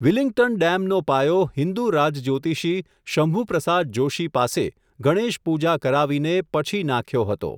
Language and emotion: Gujarati, neutral